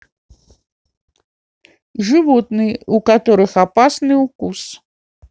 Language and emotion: Russian, neutral